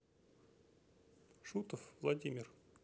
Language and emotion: Russian, neutral